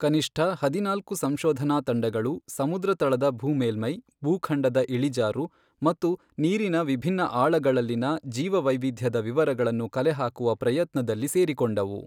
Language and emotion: Kannada, neutral